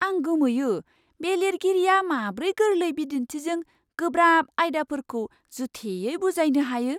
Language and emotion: Bodo, surprised